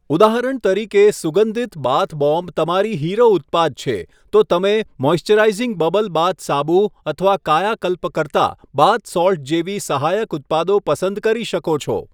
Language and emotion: Gujarati, neutral